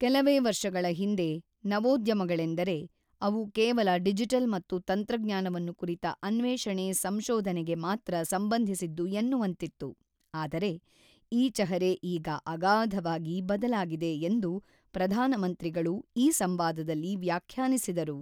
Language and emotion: Kannada, neutral